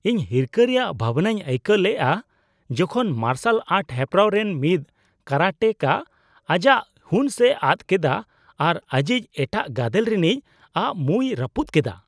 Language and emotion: Santali, disgusted